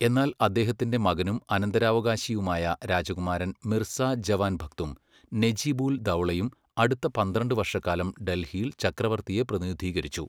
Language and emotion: Malayalam, neutral